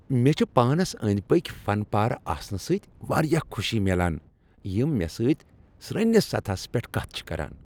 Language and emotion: Kashmiri, happy